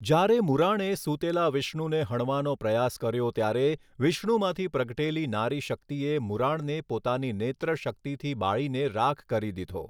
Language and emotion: Gujarati, neutral